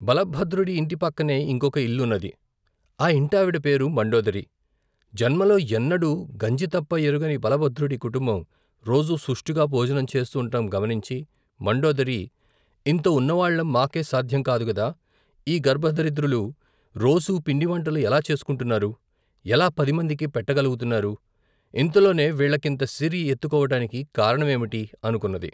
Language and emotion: Telugu, neutral